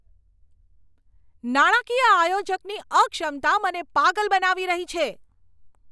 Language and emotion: Gujarati, angry